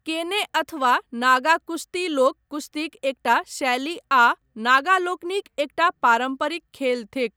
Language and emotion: Maithili, neutral